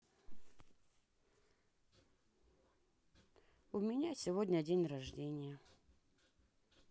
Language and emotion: Russian, sad